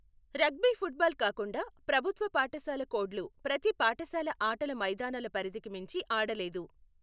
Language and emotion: Telugu, neutral